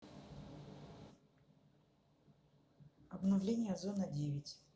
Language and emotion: Russian, neutral